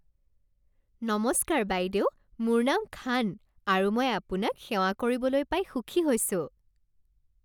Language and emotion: Assamese, happy